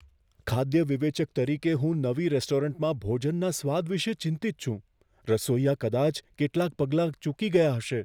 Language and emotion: Gujarati, fearful